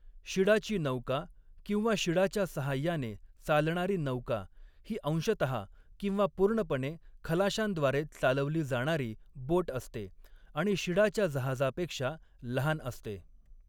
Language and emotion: Marathi, neutral